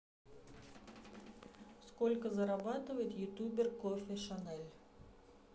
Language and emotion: Russian, neutral